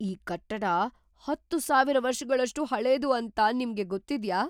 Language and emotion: Kannada, surprised